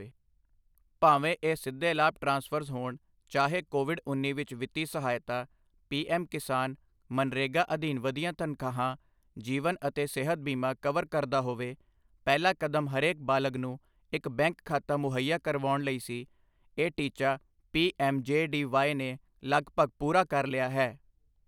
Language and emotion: Punjabi, neutral